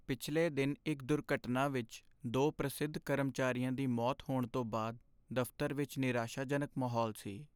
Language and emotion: Punjabi, sad